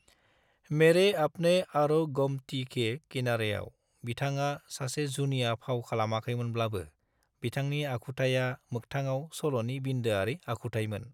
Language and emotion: Bodo, neutral